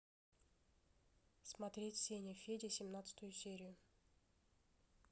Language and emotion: Russian, neutral